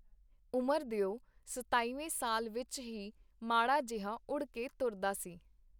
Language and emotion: Punjabi, neutral